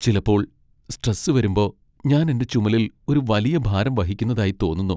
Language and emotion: Malayalam, sad